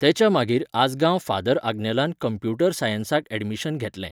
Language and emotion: Goan Konkani, neutral